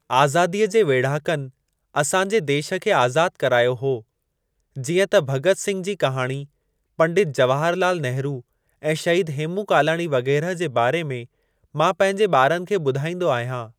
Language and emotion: Sindhi, neutral